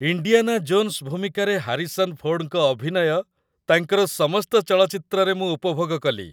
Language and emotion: Odia, happy